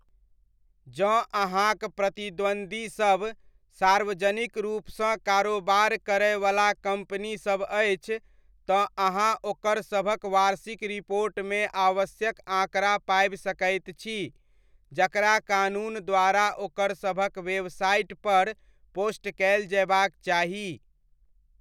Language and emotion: Maithili, neutral